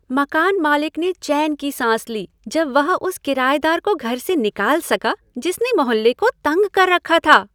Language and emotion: Hindi, happy